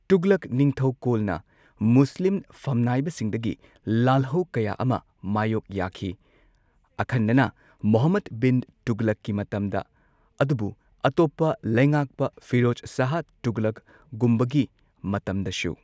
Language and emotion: Manipuri, neutral